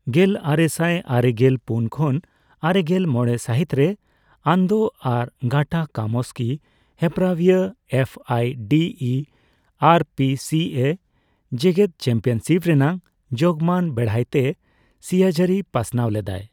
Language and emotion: Santali, neutral